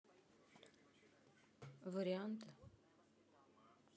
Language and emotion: Russian, neutral